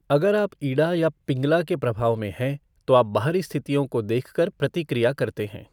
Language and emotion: Hindi, neutral